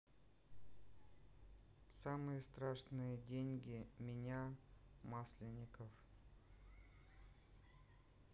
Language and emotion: Russian, neutral